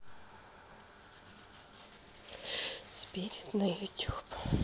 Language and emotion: Russian, sad